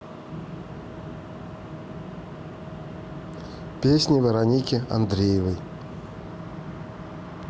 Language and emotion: Russian, neutral